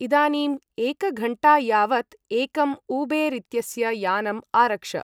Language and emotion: Sanskrit, neutral